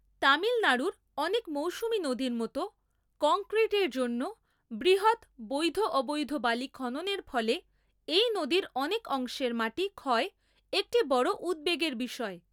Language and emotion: Bengali, neutral